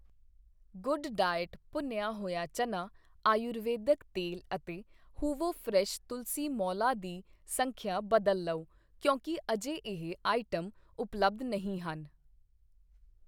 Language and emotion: Punjabi, neutral